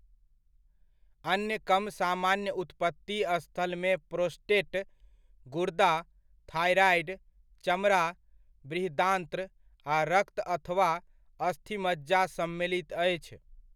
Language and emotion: Maithili, neutral